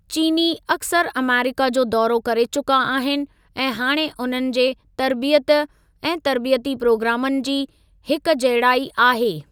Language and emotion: Sindhi, neutral